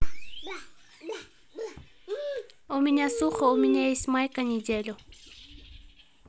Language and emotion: Russian, neutral